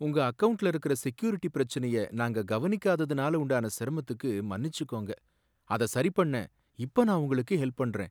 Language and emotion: Tamil, sad